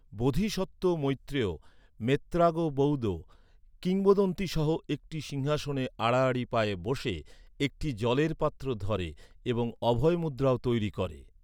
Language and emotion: Bengali, neutral